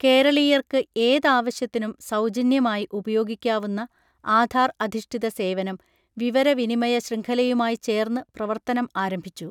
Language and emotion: Malayalam, neutral